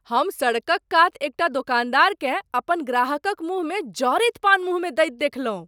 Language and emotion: Maithili, surprised